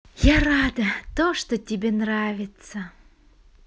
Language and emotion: Russian, positive